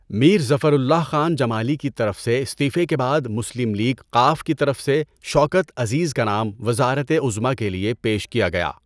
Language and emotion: Urdu, neutral